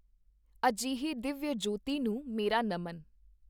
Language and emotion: Punjabi, neutral